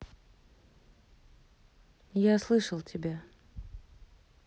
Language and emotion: Russian, neutral